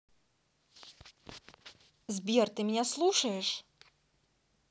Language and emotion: Russian, neutral